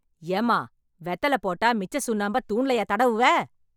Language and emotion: Tamil, angry